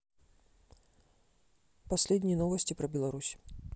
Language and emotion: Russian, neutral